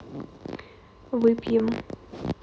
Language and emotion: Russian, neutral